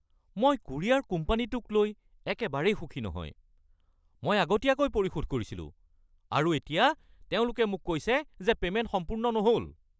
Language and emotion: Assamese, angry